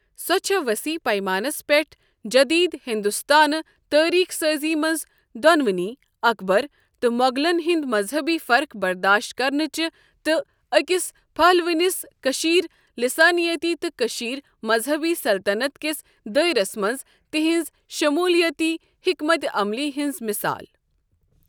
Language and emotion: Kashmiri, neutral